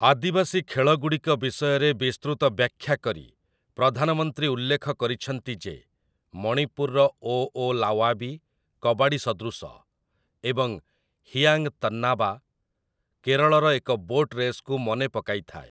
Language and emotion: Odia, neutral